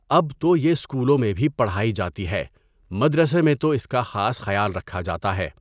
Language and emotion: Urdu, neutral